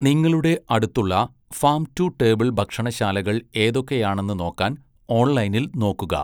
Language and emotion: Malayalam, neutral